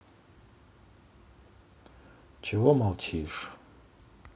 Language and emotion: Russian, sad